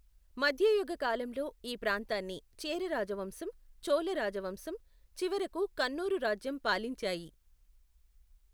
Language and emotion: Telugu, neutral